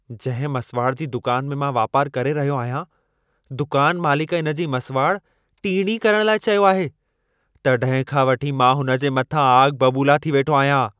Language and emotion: Sindhi, angry